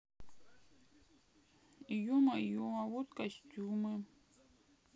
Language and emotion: Russian, sad